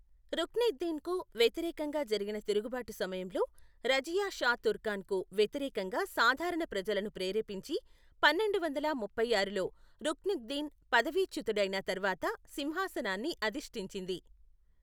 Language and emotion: Telugu, neutral